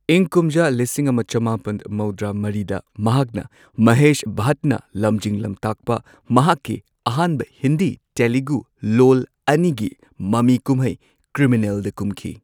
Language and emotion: Manipuri, neutral